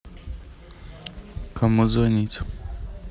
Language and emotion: Russian, neutral